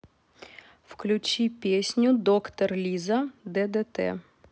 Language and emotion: Russian, neutral